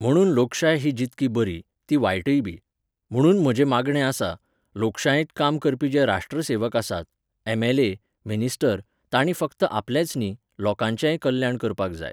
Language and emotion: Goan Konkani, neutral